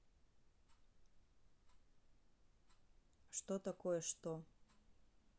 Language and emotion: Russian, neutral